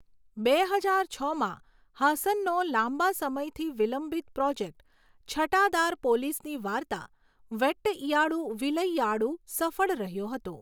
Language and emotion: Gujarati, neutral